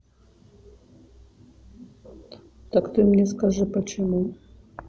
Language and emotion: Russian, neutral